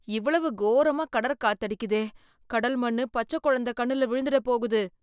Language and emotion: Tamil, fearful